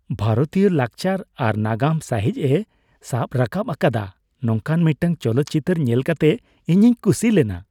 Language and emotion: Santali, happy